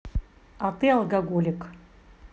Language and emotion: Russian, neutral